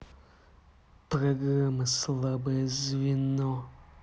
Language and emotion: Russian, angry